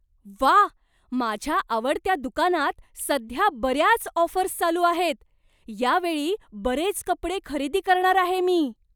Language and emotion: Marathi, surprised